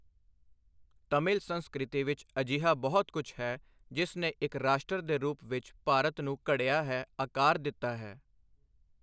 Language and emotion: Punjabi, neutral